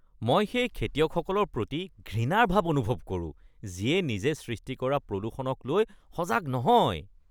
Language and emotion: Assamese, disgusted